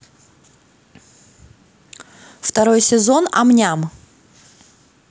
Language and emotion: Russian, neutral